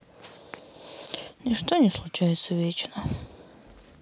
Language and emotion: Russian, sad